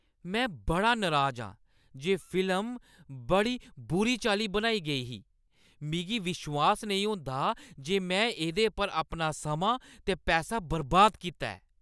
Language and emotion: Dogri, angry